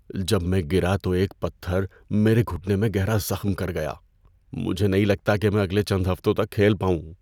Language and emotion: Urdu, fearful